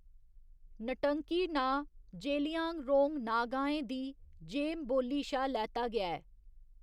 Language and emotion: Dogri, neutral